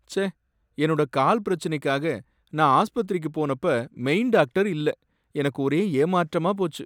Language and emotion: Tamil, sad